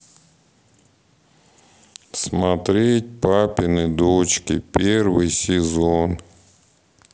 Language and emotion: Russian, sad